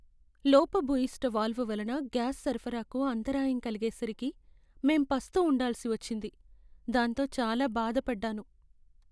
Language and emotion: Telugu, sad